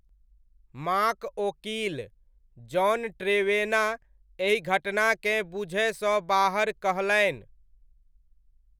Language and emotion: Maithili, neutral